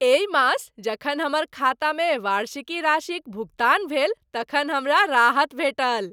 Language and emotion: Maithili, happy